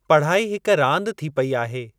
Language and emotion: Sindhi, neutral